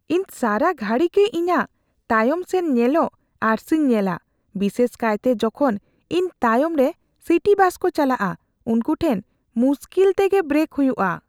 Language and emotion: Santali, fearful